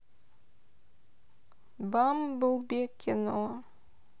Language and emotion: Russian, neutral